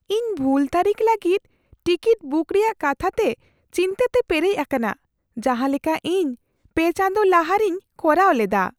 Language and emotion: Santali, fearful